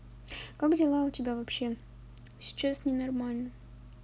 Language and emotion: Russian, neutral